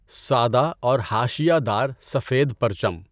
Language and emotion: Urdu, neutral